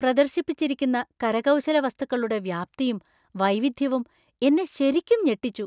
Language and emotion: Malayalam, surprised